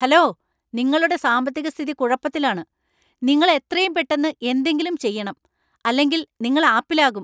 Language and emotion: Malayalam, angry